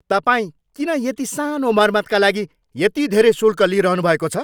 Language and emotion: Nepali, angry